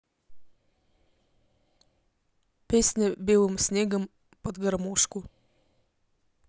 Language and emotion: Russian, neutral